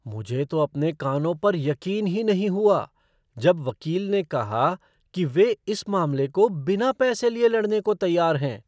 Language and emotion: Hindi, surprised